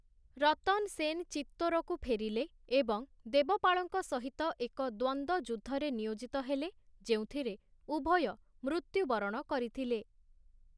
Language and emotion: Odia, neutral